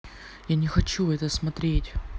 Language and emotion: Russian, neutral